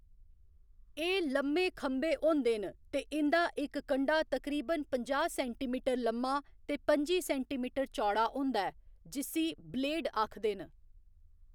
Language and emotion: Dogri, neutral